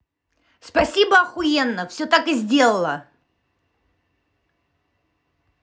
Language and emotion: Russian, angry